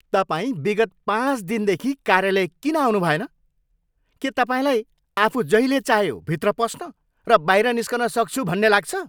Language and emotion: Nepali, angry